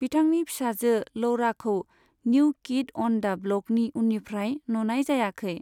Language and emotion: Bodo, neutral